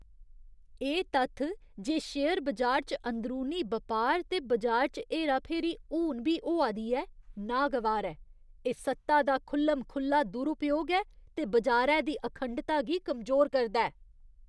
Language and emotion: Dogri, disgusted